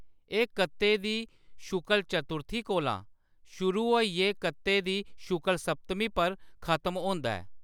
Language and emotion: Dogri, neutral